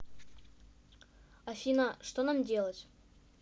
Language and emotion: Russian, neutral